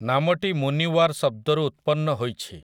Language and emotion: Odia, neutral